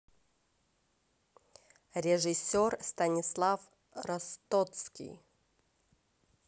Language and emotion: Russian, neutral